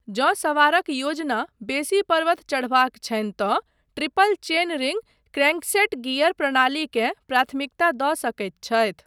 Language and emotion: Maithili, neutral